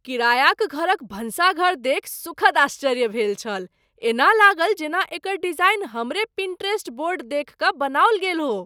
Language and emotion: Maithili, surprised